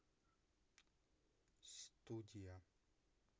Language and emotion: Russian, neutral